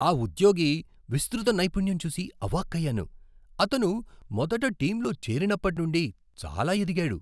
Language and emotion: Telugu, surprised